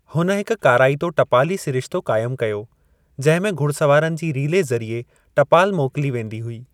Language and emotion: Sindhi, neutral